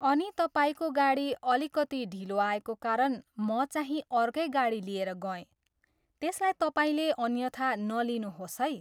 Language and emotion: Nepali, neutral